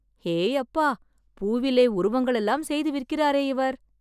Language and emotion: Tamil, surprised